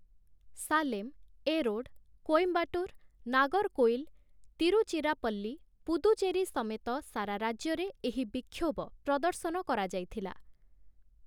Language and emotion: Odia, neutral